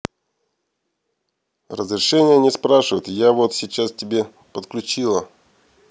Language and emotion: Russian, neutral